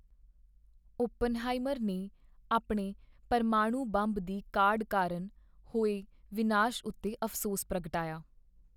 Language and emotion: Punjabi, sad